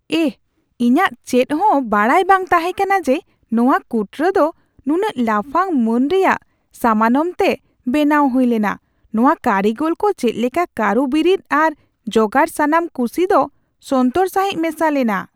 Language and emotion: Santali, surprised